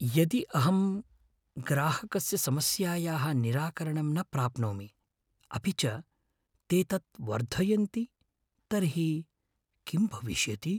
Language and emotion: Sanskrit, fearful